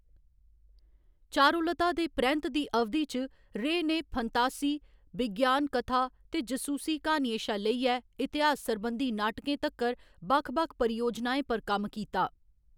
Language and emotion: Dogri, neutral